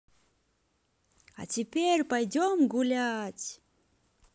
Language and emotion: Russian, positive